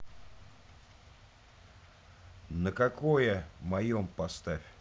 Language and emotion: Russian, neutral